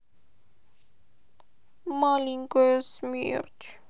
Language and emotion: Russian, sad